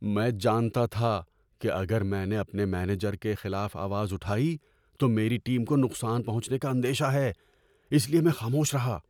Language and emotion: Urdu, fearful